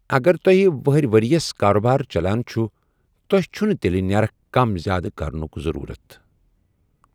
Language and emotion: Kashmiri, neutral